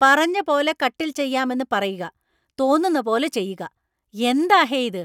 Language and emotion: Malayalam, angry